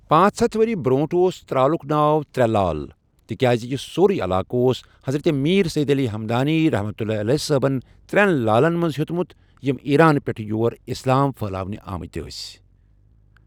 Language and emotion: Kashmiri, neutral